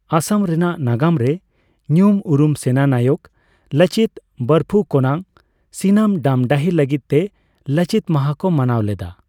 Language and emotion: Santali, neutral